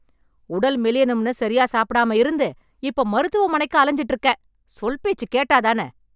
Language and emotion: Tamil, angry